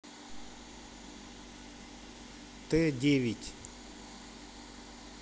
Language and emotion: Russian, neutral